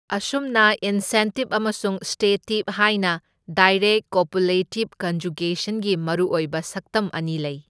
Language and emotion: Manipuri, neutral